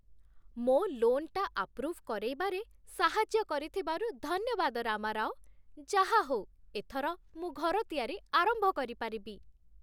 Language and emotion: Odia, happy